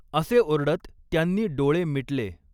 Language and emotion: Marathi, neutral